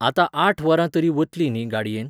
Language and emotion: Goan Konkani, neutral